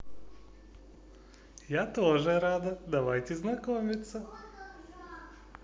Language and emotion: Russian, positive